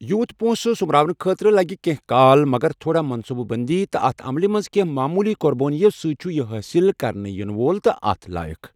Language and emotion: Kashmiri, neutral